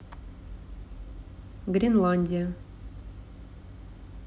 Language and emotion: Russian, neutral